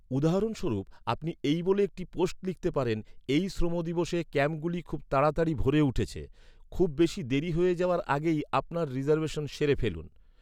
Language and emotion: Bengali, neutral